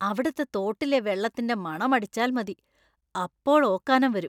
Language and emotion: Malayalam, disgusted